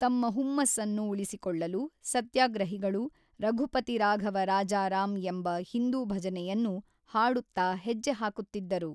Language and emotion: Kannada, neutral